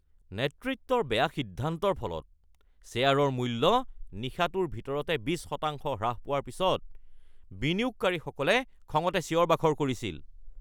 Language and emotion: Assamese, angry